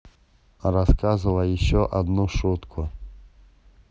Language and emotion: Russian, neutral